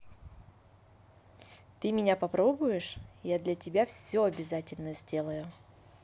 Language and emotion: Russian, positive